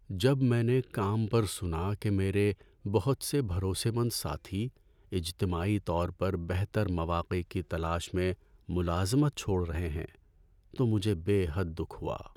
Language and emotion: Urdu, sad